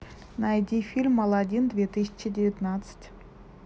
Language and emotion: Russian, neutral